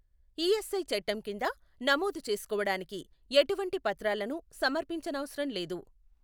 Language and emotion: Telugu, neutral